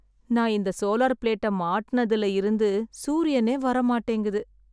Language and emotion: Tamil, sad